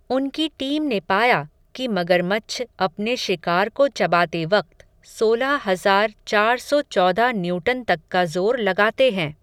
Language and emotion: Hindi, neutral